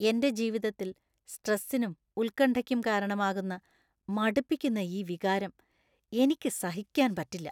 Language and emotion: Malayalam, disgusted